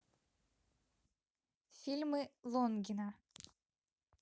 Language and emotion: Russian, neutral